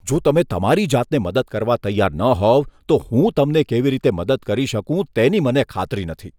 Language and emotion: Gujarati, disgusted